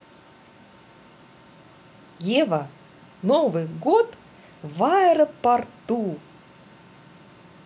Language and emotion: Russian, positive